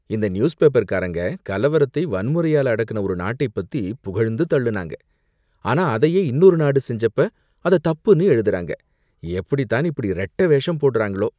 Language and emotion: Tamil, disgusted